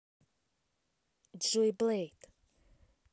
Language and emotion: Russian, neutral